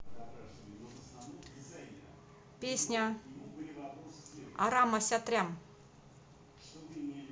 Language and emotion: Russian, neutral